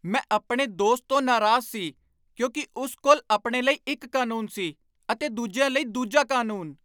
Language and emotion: Punjabi, angry